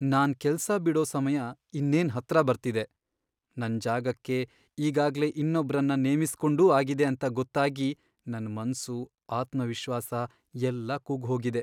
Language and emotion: Kannada, sad